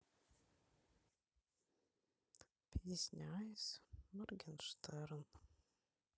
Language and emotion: Russian, sad